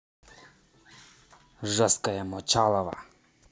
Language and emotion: Russian, angry